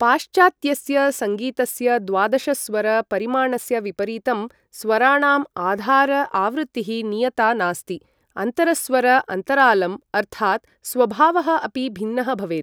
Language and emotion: Sanskrit, neutral